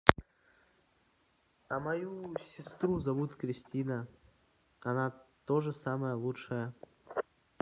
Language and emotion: Russian, neutral